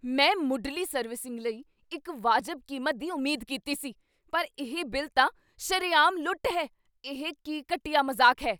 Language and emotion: Punjabi, angry